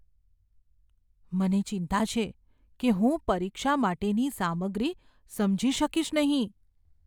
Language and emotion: Gujarati, fearful